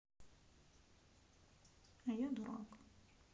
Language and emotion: Russian, sad